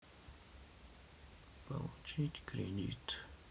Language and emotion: Russian, sad